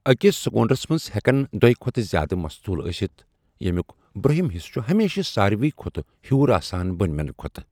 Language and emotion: Kashmiri, neutral